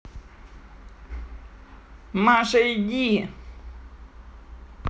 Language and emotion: Russian, angry